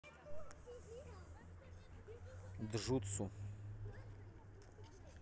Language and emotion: Russian, neutral